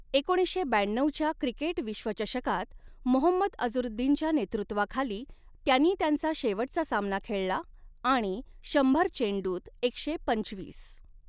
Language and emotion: Marathi, neutral